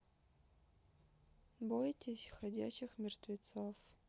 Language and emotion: Russian, neutral